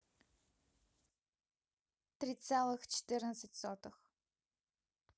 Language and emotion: Russian, neutral